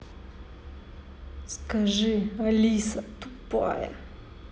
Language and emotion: Russian, angry